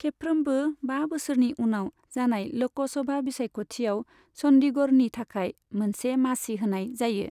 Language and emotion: Bodo, neutral